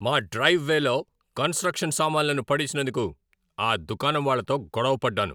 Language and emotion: Telugu, angry